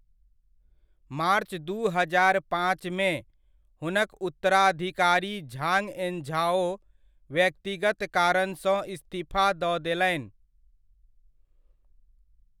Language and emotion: Maithili, neutral